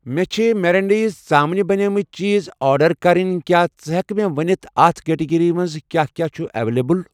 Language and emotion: Kashmiri, neutral